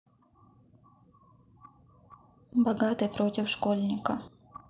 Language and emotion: Russian, neutral